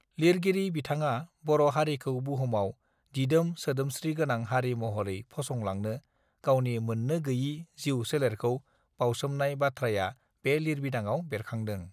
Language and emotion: Bodo, neutral